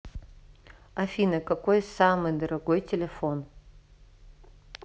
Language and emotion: Russian, neutral